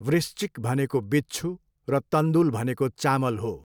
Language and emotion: Nepali, neutral